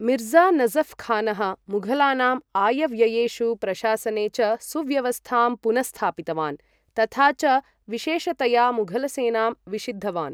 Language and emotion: Sanskrit, neutral